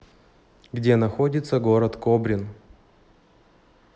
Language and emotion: Russian, neutral